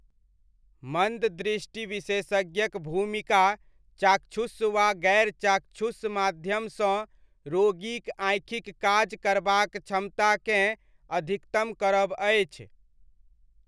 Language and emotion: Maithili, neutral